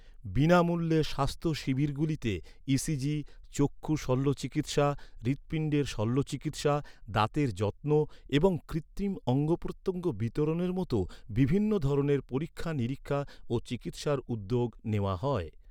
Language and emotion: Bengali, neutral